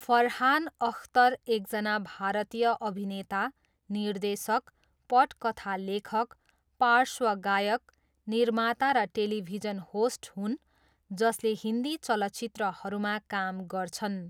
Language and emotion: Nepali, neutral